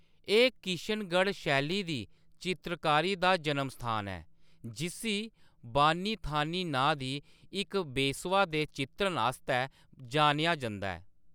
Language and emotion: Dogri, neutral